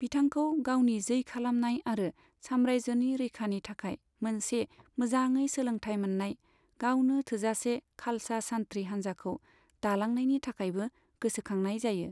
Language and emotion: Bodo, neutral